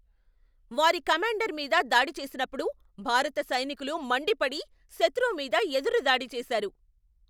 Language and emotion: Telugu, angry